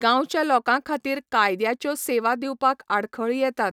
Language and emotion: Goan Konkani, neutral